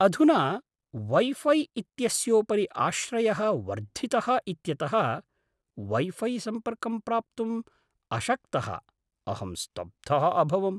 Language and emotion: Sanskrit, surprised